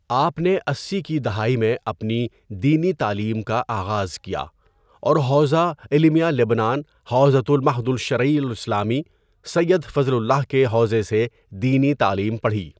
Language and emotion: Urdu, neutral